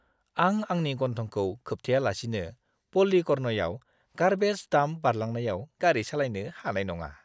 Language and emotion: Bodo, disgusted